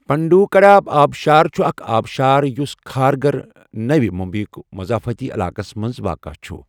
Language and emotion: Kashmiri, neutral